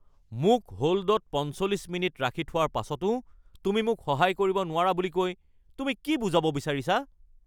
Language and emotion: Assamese, angry